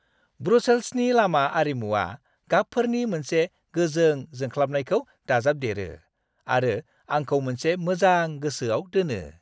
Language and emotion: Bodo, happy